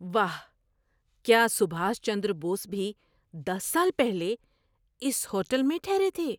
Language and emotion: Urdu, surprised